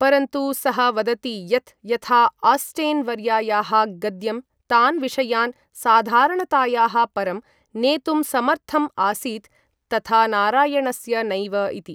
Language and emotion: Sanskrit, neutral